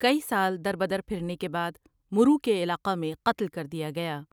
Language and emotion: Urdu, neutral